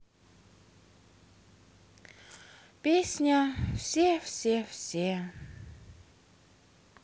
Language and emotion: Russian, sad